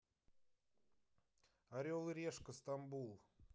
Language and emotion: Russian, neutral